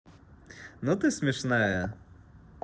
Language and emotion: Russian, positive